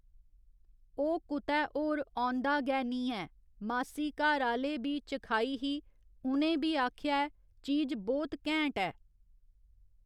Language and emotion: Dogri, neutral